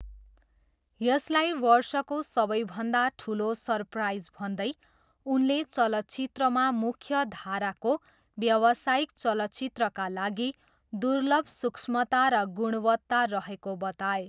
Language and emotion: Nepali, neutral